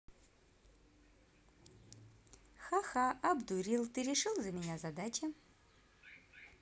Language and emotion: Russian, positive